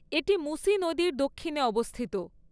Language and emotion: Bengali, neutral